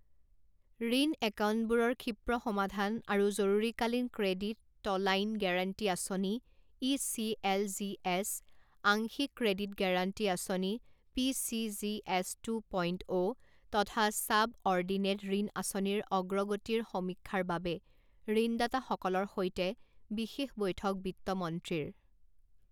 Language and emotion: Assamese, neutral